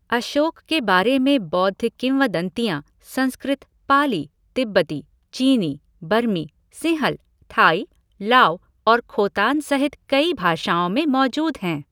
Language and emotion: Hindi, neutral